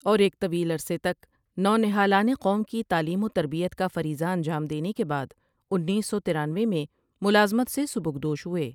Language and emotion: Urdu, neutral